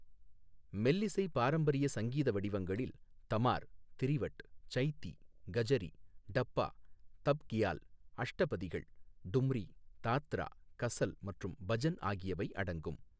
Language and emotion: Tamil, neutral